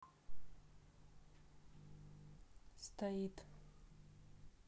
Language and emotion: Russian, neutral